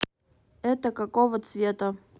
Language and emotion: Russian, neutral